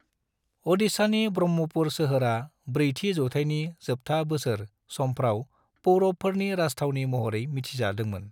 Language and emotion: Bodo, neutral